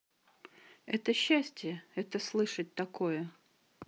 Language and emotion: Russian, neutral